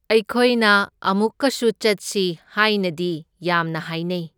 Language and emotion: Manipuri, neutral